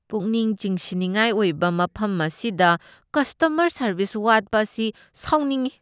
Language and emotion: Manipuri, disgusted